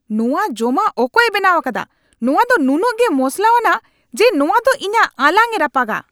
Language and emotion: Santali, angry